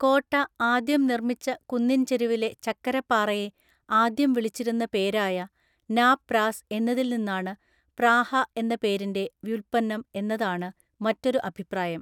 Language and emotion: Malayalam, neutral